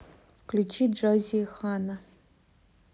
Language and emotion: Russian, neutral